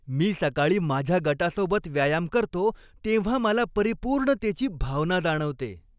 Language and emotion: Marathi, happy